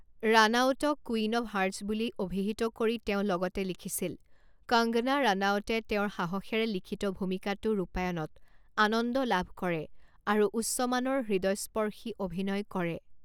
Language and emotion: Assamese, neutral